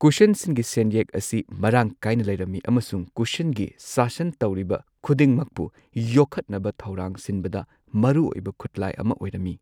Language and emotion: Manipuri, neutral